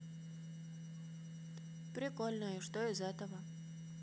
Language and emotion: Russian, neutral